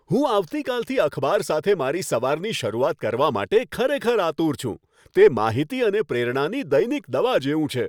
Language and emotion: Gujarati, happy